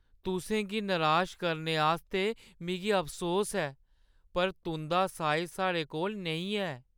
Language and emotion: Dogri, sad